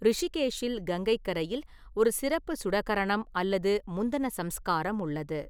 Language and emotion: Tamil, neutral